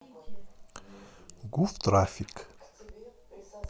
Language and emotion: Russian, neutral